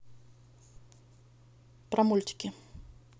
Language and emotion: Russian, neutral